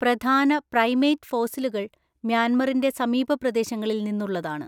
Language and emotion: Malayalam, neutral